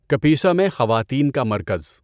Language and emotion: Urdu, neutral